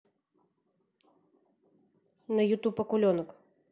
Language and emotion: Russian, neutral